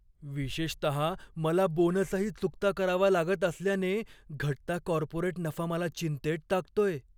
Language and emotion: Marathi, fearful